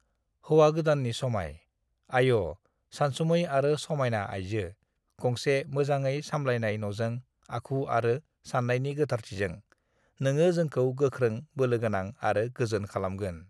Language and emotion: Bodo, neutral